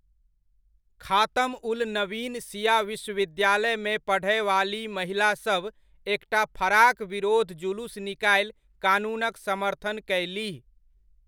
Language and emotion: Maithili, neutral